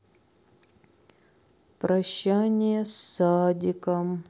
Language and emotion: Russian, sad